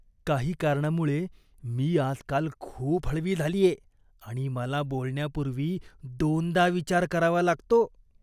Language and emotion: Marathi, disgusted